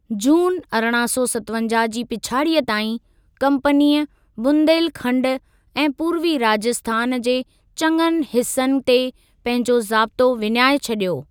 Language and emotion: Sindhi, neutral